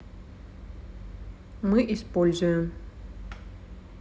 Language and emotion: Russian, neutral